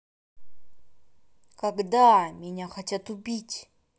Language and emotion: Russian, angry